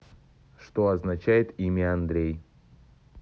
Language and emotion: Russian, neutral